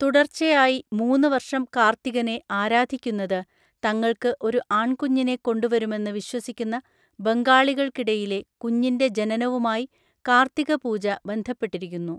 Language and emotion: Malayalam, neutral